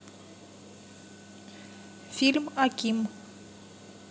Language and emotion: Russian, neutral